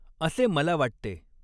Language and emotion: Marathi, neutral